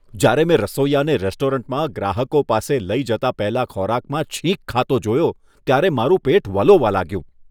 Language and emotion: Gujarati, disgusted